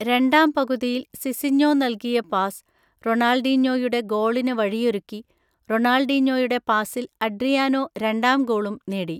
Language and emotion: Malayalam, neutral